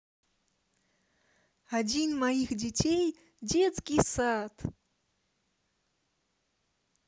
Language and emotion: Russian, positive